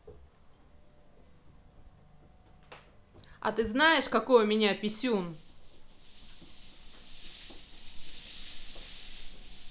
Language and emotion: Russian, angry